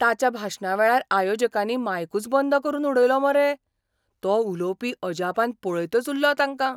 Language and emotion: Goan Konkani, surprised